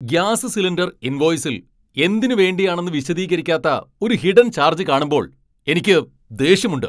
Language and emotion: Malayalam, angry